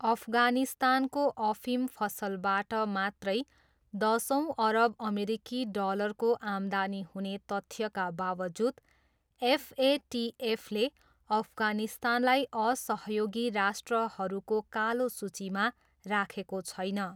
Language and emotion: Nepali, neutral